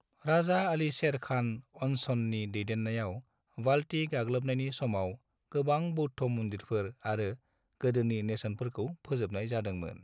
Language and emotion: Bodo, neutral